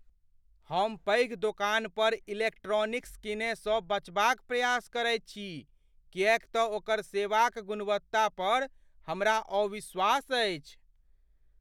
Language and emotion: Maithili, fearful